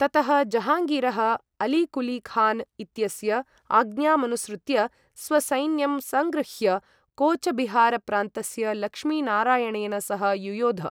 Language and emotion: Sanskrit, neutral